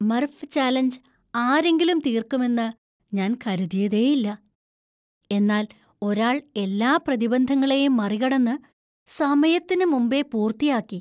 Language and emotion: Malayalam, surprised